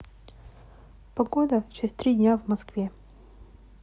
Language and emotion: Russian, neutral